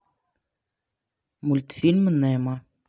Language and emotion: Russian, neutral